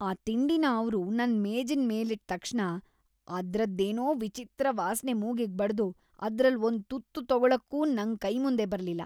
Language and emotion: Kannada, disgusted